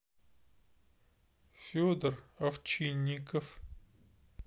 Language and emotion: Russian, neutral